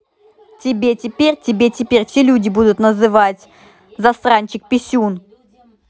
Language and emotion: Russian, angry